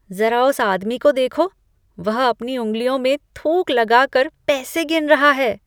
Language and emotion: Hindi, disgusted